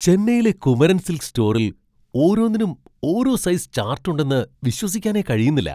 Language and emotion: Malayalam, surprised